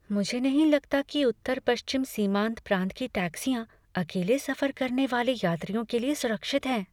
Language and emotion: Hindi, fearful